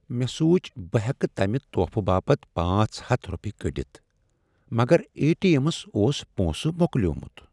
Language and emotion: Kashmiri, sad